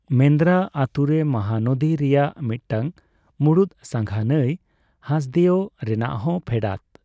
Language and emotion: Santali, neutral